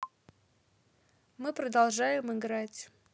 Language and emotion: Russian, neutral